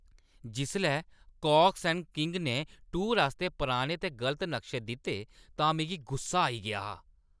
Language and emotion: Dogri, angry